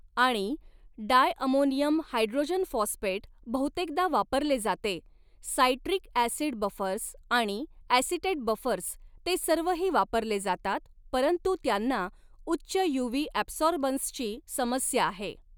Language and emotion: Marathi, neutral